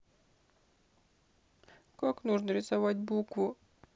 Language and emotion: Russian, sad